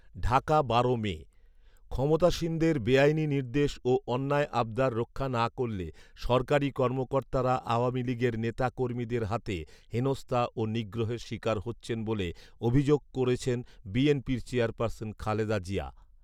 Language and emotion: Bengali, neutral